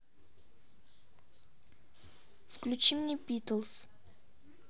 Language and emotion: Russian, neutral